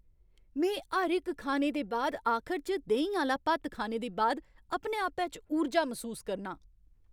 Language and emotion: Dogri, happy